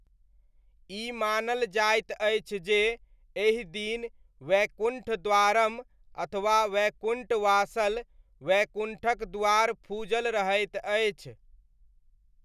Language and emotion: Maithili, neutral